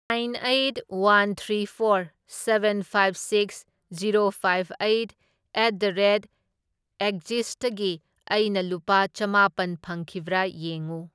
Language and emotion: Manipuri, neutral